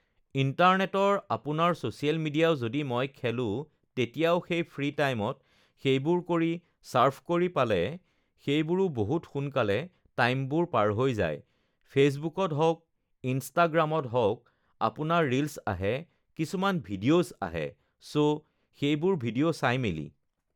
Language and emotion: Assamese, neutral